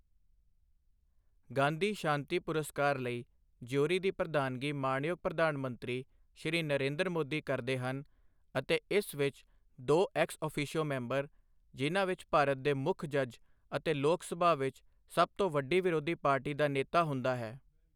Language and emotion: Punjabi, neutral